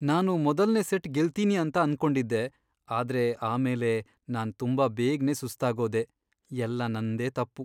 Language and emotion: Kannada, sad